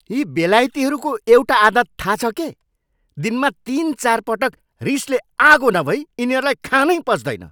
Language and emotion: Nepali, angry